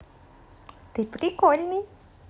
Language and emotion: Russian, positive